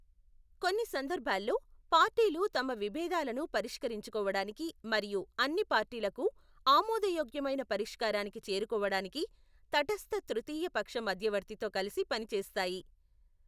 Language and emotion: Telugu, neutral